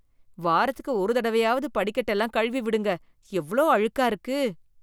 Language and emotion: Tamil, disgusted